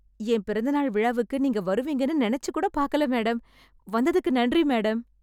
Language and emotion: Tamil, surprised